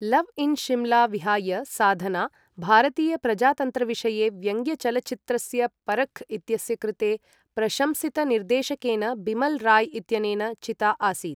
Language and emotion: Sanskrit, neutral